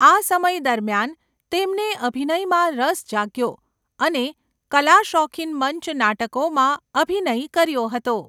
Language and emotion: Gujarati, neutral